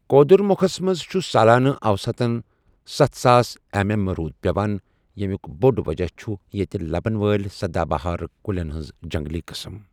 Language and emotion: Kashmiri, neutral